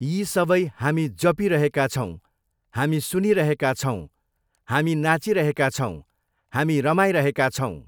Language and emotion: Nepali, neutral